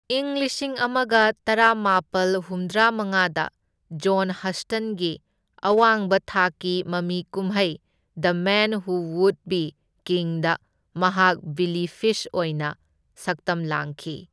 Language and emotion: Manipuri, neutral